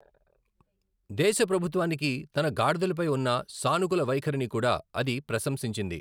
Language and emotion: Telugu, neutral